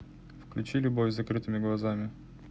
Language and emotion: Russian, neutral